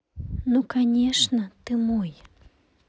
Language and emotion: Russian, neutral